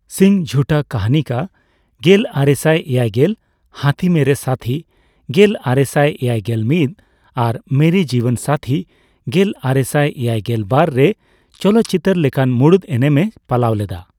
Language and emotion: Santali, neutral